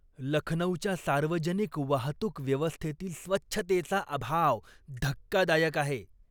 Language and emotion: Marathi, disgusted